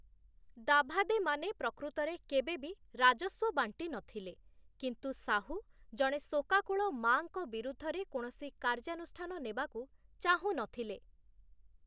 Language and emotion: Odia, neutral